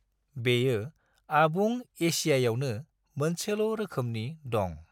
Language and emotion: Bodo, neutral